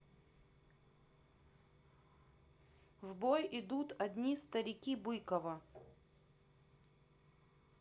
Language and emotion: Russian, neutral